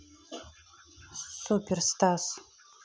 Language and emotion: Russian, neutral